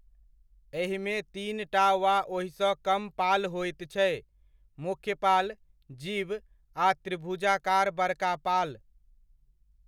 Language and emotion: Maithili, neutral